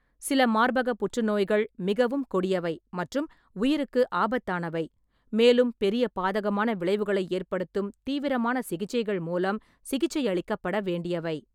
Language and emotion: Tamil, neutral